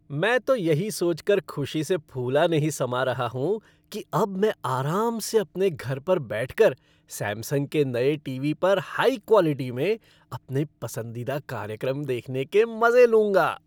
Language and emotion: Hindi, happy